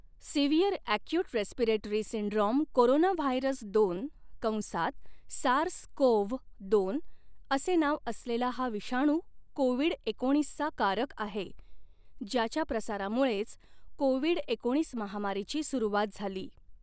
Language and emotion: Marathi, neutral